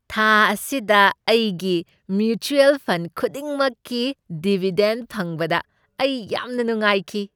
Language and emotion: Manipuri, happy